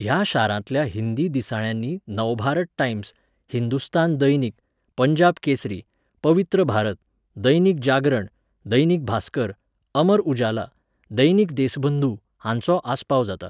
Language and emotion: Goan Konkani, neutral